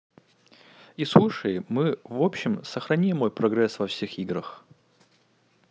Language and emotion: Russian, neutral